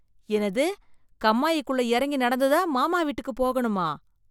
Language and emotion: Tamil, disgusted